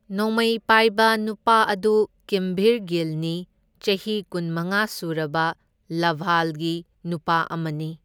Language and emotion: Manipuri, neutral